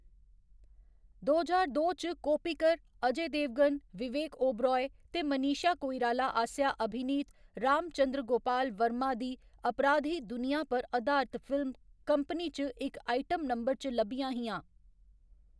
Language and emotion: Dogri, neutral